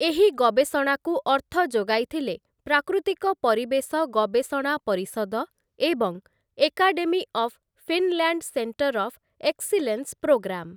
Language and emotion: Odia, neutral